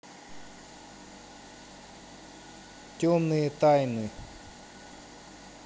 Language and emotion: Russian, neutral